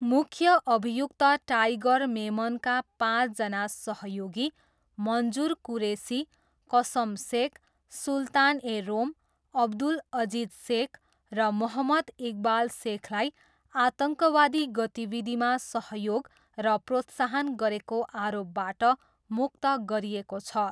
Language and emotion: Nepali, neutral